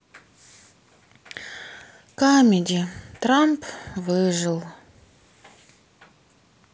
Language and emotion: Russian, sad